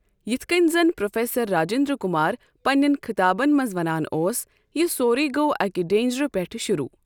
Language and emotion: Kashmiri, neutral